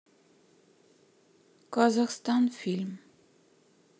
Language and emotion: Russian, neutral